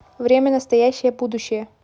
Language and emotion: Russian, neutral